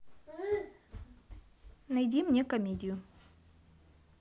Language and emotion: Russian, neutral